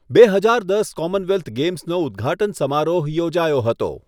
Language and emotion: Gujarati, neutral